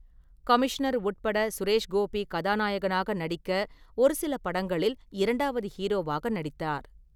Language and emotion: Tamil, neutral